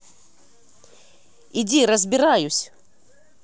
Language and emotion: Russian, angry